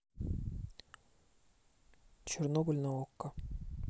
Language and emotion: Russian, neutral